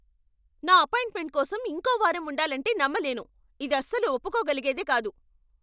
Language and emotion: Telugu, angry